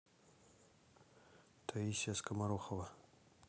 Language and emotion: Russian, neutral